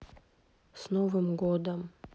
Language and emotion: Russian, sad